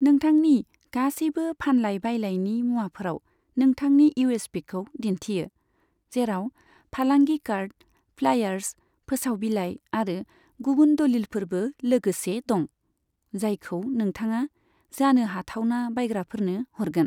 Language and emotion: Bodo, neutral